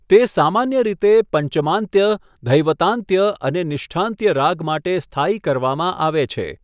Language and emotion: Gujarati, neutral